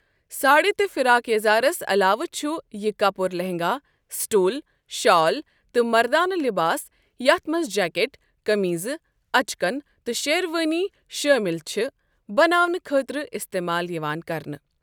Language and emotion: Kashmiri, neutral